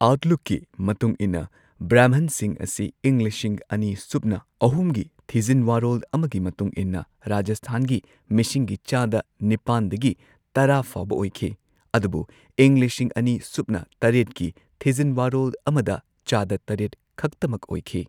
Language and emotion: Manipuri, neutral